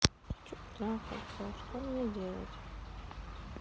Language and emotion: Russian, sad